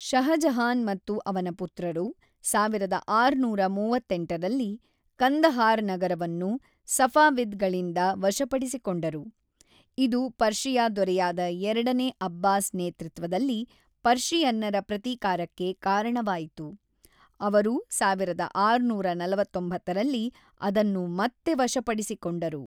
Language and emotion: Kannada, neutral